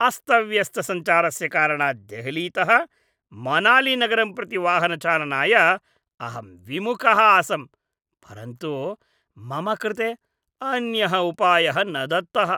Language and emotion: Sanskrit, disgusted